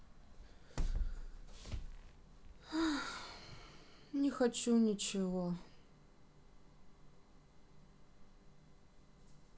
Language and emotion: Russian, sad